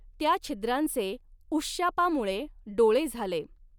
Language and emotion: Marathi, neutral